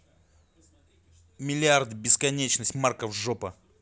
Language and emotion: Russian, angry